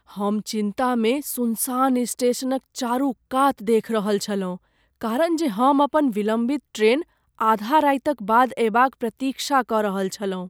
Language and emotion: Maithili, fearful